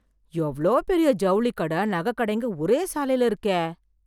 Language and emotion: Tamil, surprised